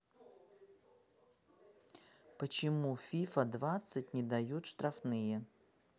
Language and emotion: Russian, neutral